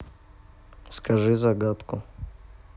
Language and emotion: Russian, neutral